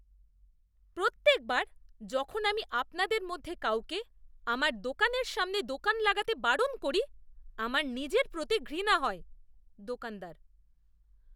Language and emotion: Bengali, disgusted